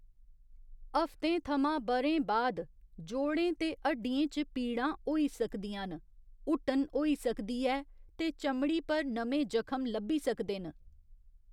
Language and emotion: Dogri, neutral